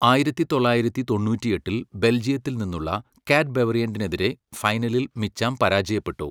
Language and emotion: Malayalam, neutral